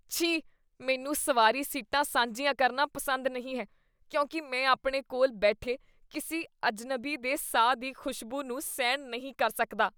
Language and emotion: Punjabi, disgusted